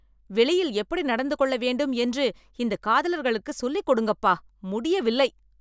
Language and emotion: Tamil, angry